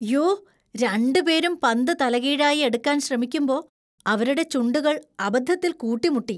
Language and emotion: Malayalam, disgusted